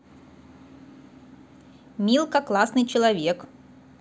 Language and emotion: Russian, positive